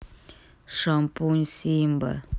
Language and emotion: Russian, neutral